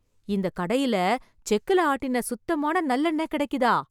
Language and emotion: Tamil, surprised